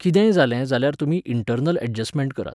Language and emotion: Goan Konkani, neutral